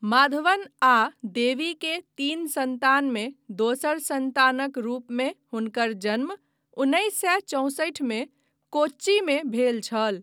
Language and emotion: Maithili, neutral